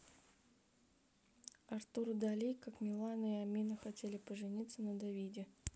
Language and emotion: Russian, neutral